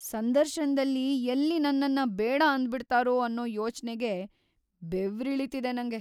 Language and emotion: Kannada, fearful